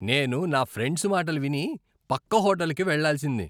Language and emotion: Telugu, disgusted